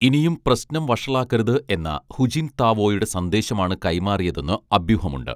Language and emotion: Malayalam, neutral